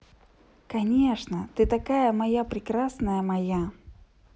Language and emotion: Russian, positive